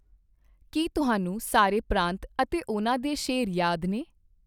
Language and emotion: Punjabi, neutral